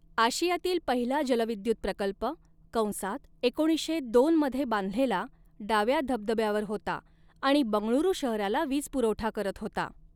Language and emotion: Marathi, neutral